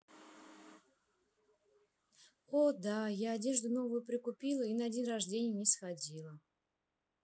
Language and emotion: Russian, sad